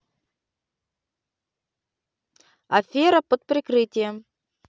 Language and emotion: Russian, neutral